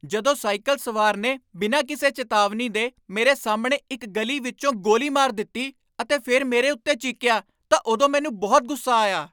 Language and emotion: Punjabi, angry